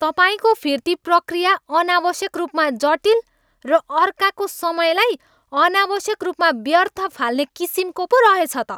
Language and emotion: Nepali, angry